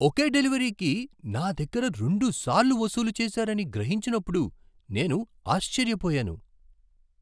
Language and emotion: Telugu, surprised